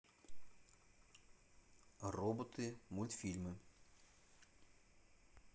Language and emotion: Russian, neutral